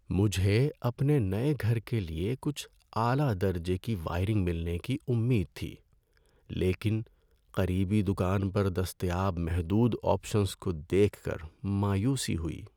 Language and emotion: Urdu, sad